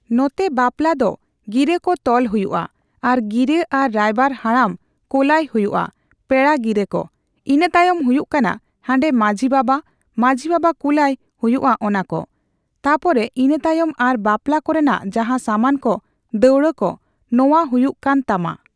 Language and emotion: Santali, neutral